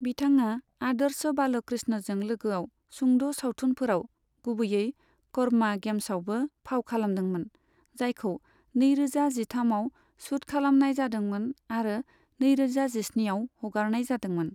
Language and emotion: Bodo, neutral